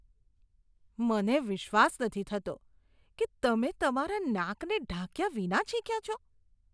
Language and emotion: Gujarati, disgusted